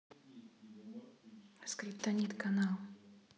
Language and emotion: Russian, neutral